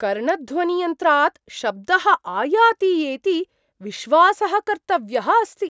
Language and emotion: Sanskrit, surprised